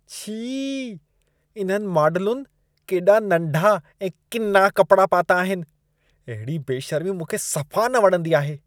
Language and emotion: Sindhi, disgusted